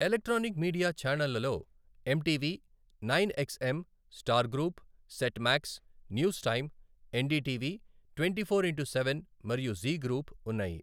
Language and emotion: Telugu, neutral